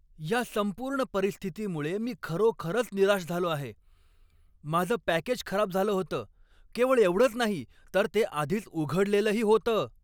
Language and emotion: Marathi, angry